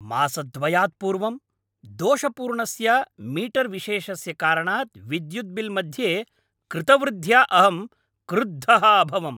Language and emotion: Sanskrit, angry